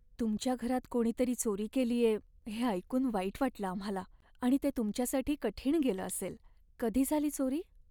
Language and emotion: Marathi, sad